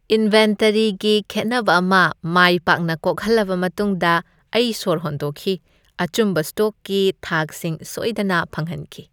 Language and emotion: Manipuri, happy